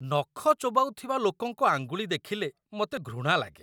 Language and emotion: Odia, disgusted